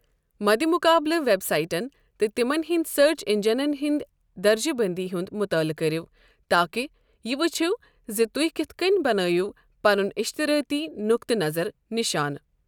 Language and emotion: Kashmiri, neutral